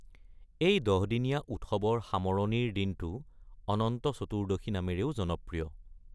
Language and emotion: Assamese, neutral